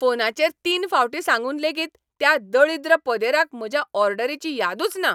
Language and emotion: Goan Konkani, angry